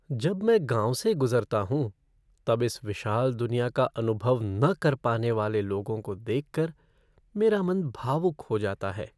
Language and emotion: Hindi, sad